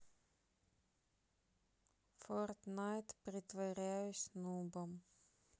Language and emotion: Russian, sad